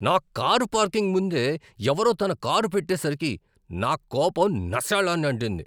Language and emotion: Telugu, angry